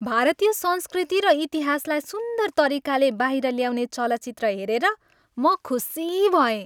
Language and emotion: Nepali, happy